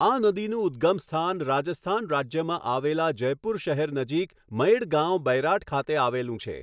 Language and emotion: Gujarati, neutral